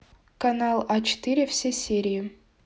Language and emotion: Russian, neutral